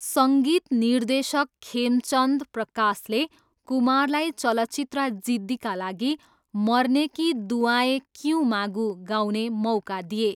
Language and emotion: Nepali, neutral